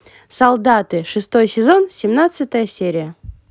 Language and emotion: Russian, positive